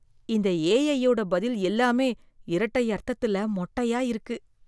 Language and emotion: Tamil, disgusted